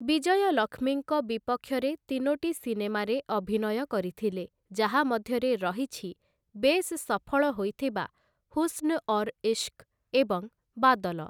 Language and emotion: Odia, neutral